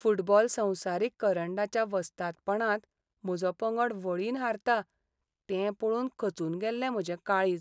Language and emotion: Goan Konkani, sad